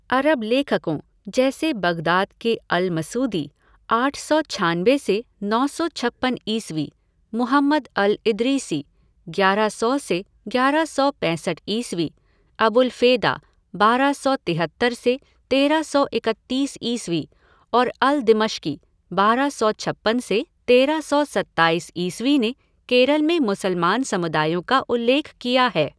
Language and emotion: Hindi, neutral